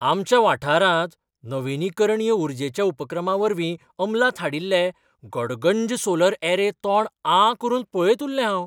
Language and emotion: Goan Konkani, surprised